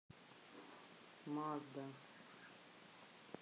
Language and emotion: Russian, neutral